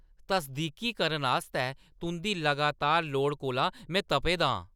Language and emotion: Dogri, angry